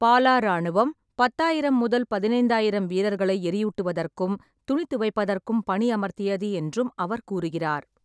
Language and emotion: Tamil, neutral